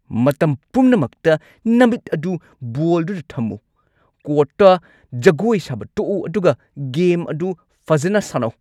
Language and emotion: Manipuri, angry